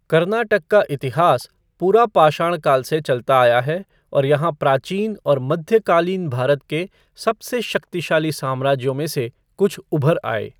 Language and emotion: Hindi, neutral